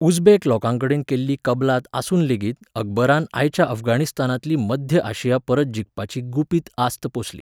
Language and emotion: Goan Konkani, neutral